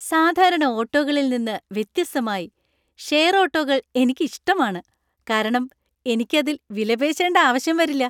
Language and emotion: Malayalam, happy